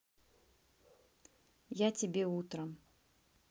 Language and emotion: Russian, neutral